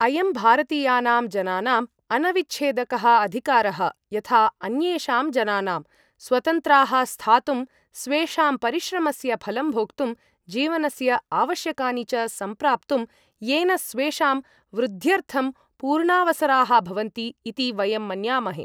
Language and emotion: Sanskrit, neutral